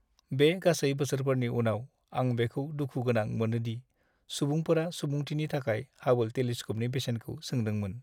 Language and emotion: Bodo, sad